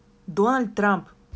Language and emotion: Russian, neutral